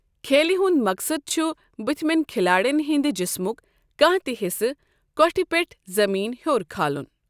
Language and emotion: Kashmiri, neutral